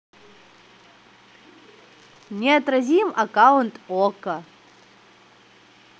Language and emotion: Russian, positive